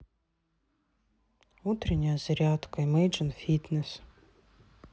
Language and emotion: Russian, sad